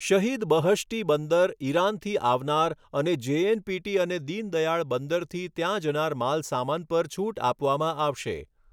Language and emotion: Gujarati, neutral